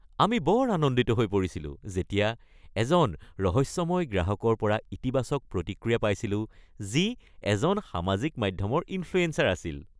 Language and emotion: Assamese, happy